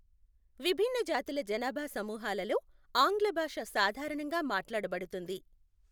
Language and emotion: Telugu, neutral